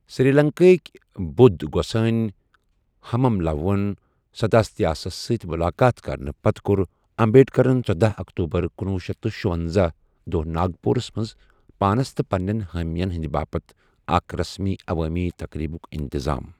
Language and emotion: Kashmiri, neutral